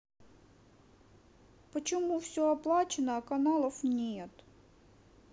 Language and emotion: Russian, sad